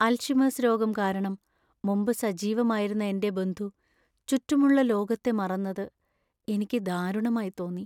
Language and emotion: Malayalam, sad